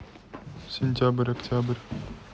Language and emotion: Russian, neutral